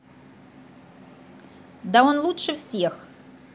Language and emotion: Russian, positive